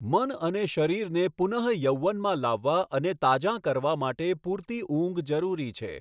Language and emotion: Gujarati, neutral